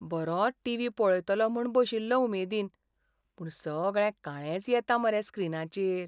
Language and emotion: Goan Konkani, sad